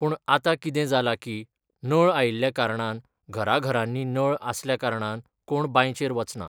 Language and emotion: Goan Konkani, neutral